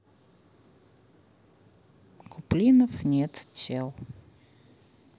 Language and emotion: Russian, neutral